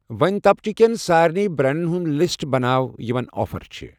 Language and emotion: Kashmiri, neutral